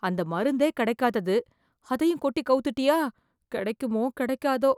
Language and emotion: Tamil, fearful